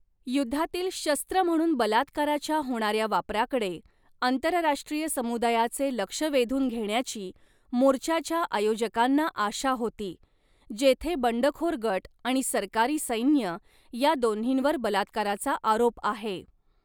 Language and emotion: Marathi, neutral